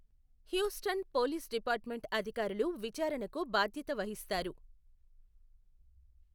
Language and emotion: Telugu, neutral